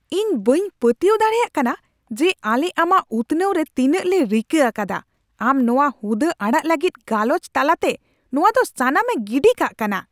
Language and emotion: Santali, angry